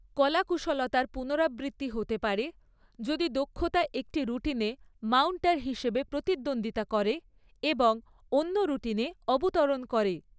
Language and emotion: Bengali, neutral